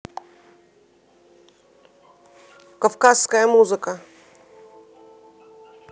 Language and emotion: Russian, neutral